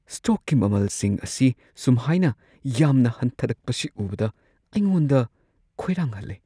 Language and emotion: Manipuri, fearful